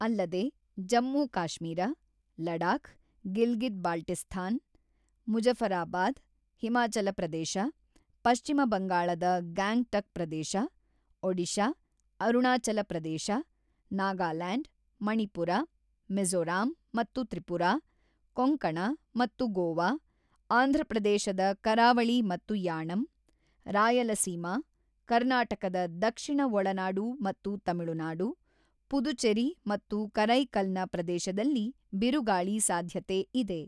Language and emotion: Kannada, neutral